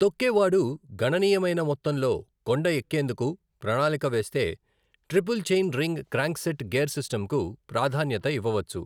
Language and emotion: Telugu, neutral